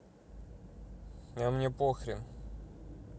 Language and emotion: Russian, neutral